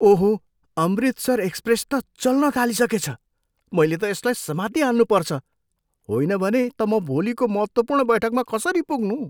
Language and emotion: Nepali, surprised